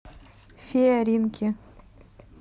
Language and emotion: Russian, neutral